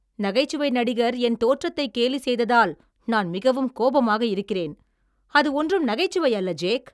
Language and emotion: Tamil, angry